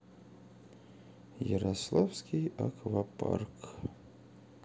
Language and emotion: Russian, sad